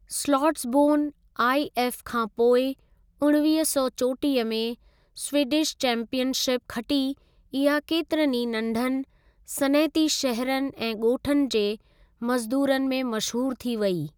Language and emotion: Sindhi, neutral